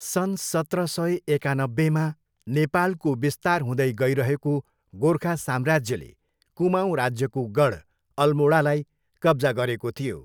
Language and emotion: Nepali, neutral